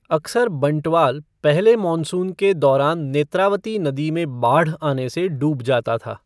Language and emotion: Hindi, neutral